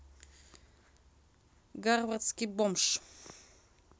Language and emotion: Russian, neutral